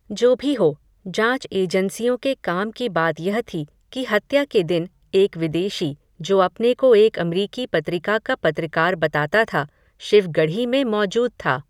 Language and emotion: Hindi, neutral